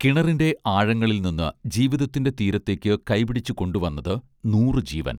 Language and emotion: Malayalam, neutral